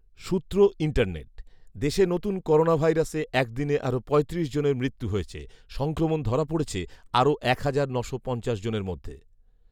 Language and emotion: Bengali, neutral